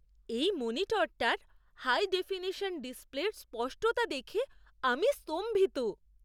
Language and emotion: Bengali, surprised